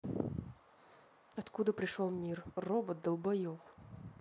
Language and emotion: Russian, angry